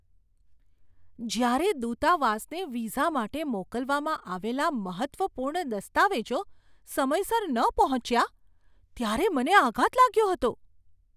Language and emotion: Gujarati, surprised